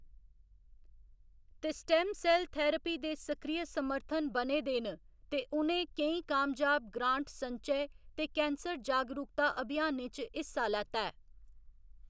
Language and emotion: Dogri, neutral